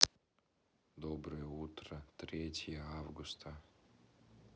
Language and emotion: Russian, neutral